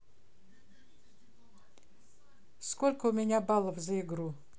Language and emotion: Russian, neutral